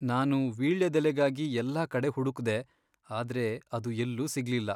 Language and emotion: Kannada, sad